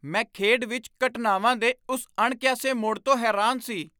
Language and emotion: Punjabi, surprised